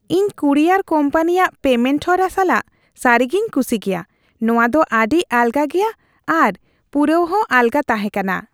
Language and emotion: Santali, happy